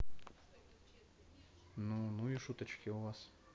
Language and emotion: Russian, neutral